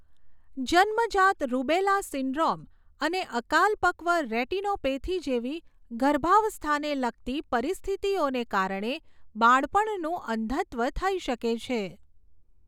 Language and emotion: Gujarati, neutral